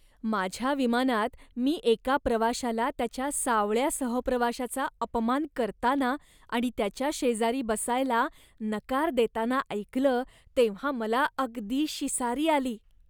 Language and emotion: Marathi, disgusted